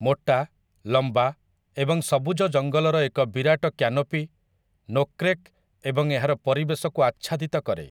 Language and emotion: Odia, neutral